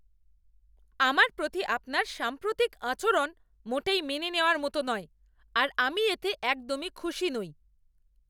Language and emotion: Bengali, angry